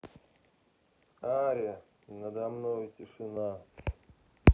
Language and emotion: Russian, neutral